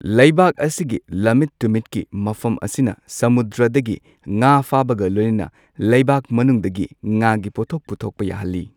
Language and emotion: Manipuri, neutral